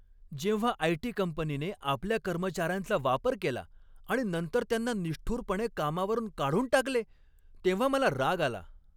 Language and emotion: Marathi, angry